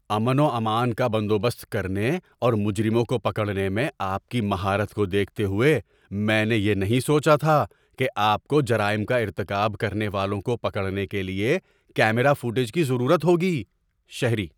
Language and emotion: Urdu, surprised